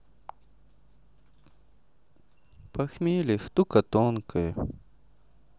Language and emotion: Russian, sad